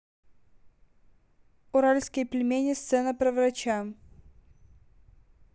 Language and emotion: Russian, neutral